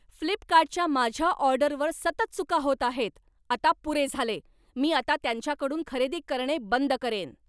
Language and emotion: Marathi, angry